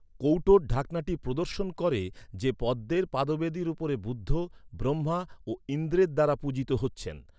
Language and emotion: Bengali, neutral